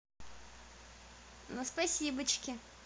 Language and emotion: Russian, positive